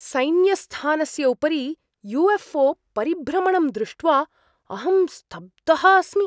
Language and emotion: Sanskrit, surprised